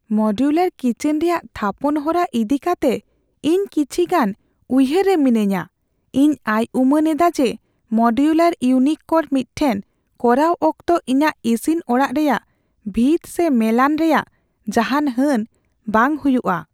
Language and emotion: Santali, fearful